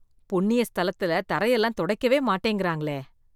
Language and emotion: Tamil, disgusted